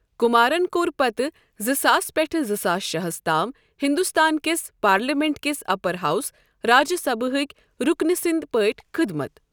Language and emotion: Kashmiri, neutral